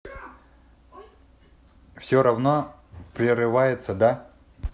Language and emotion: Russian, neutral